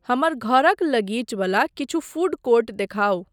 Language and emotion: Maithili, neutral